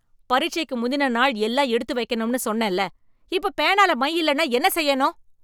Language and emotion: Tamil, angry